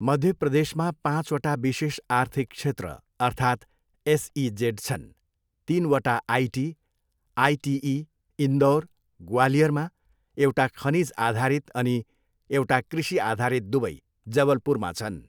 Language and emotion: Nepali, neutral